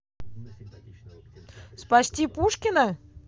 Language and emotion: Russian, positive